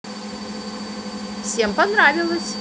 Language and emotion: Russian, positive